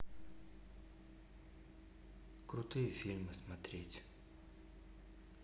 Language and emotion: Russian, neutral